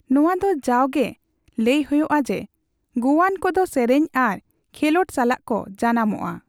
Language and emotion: Santali, neutral